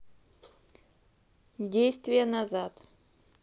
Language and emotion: Russian, neutral